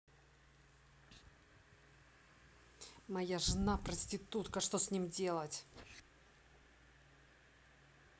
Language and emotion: Russian, angry